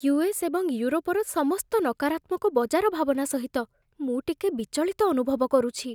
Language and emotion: Odia, fearful